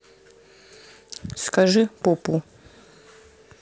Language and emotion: Russian, neutral